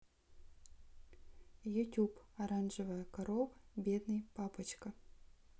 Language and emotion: Russian, neutral